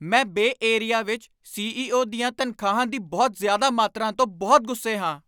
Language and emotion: Punjabi, angry